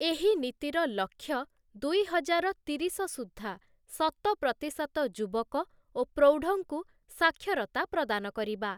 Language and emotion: Odia, neutral